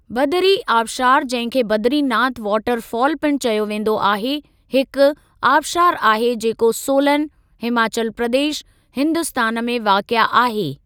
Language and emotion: Sindhi, neutral